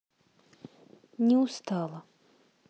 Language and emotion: Russian, sad